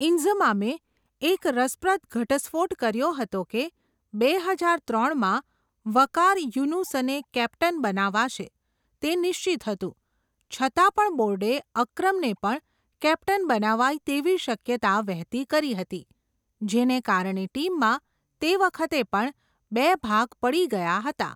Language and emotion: Gujarati, neutral